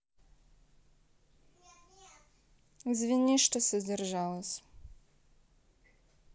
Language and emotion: Russian, neutral